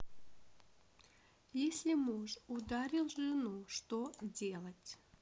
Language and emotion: Russian, neutral